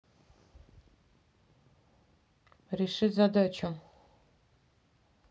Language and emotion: Russian, neutral